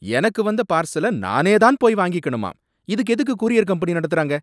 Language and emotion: Tamil, angry